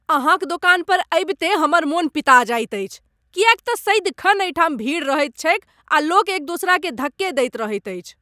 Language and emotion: Maithili, angry